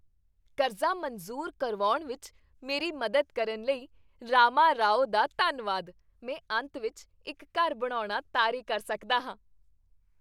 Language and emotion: Punjabi, happy